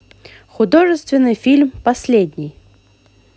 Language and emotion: Russian, positive